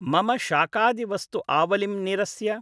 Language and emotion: Sanskrit, neutral